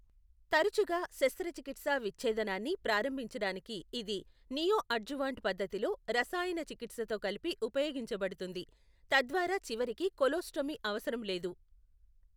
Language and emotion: Telugu, neutral